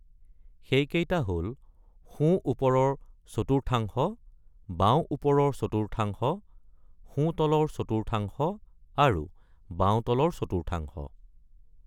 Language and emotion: Assamese, neutral